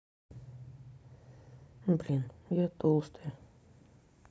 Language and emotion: Russian, sad